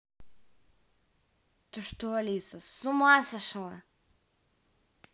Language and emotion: Russian, angry